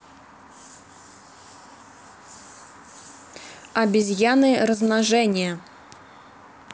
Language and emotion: Russian, neutral